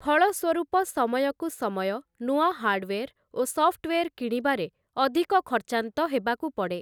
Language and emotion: Odia, neutral